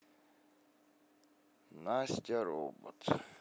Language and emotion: Russian, sad